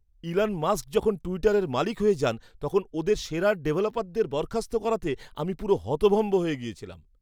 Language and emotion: Bengali, surprised